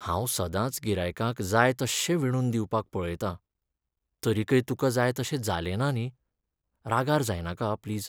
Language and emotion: Goan Konkani, sad